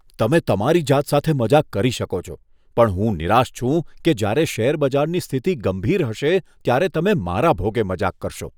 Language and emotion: Gujarati, disgusted